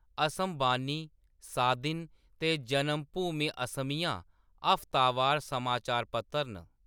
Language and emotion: Dogri, neutral